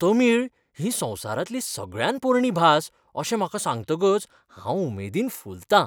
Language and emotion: Goan Konkani, happy